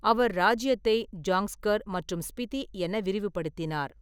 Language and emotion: Tamil, neutral